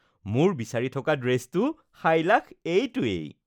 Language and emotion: Assamese, happy